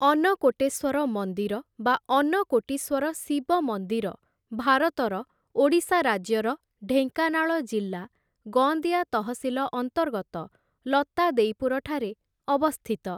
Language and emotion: Odia, neutral